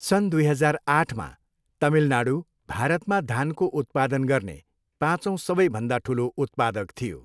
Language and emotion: Nepali, neutral